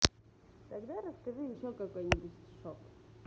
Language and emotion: Russian, positive